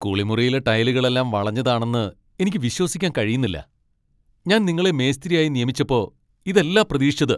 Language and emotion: Malayalam, angry